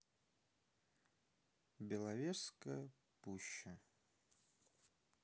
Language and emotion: Russian, sad